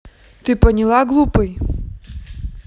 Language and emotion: Russian, angry